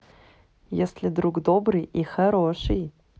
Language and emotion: Russian, positive